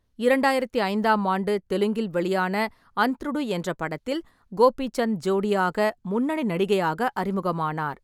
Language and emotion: Tamil, neutral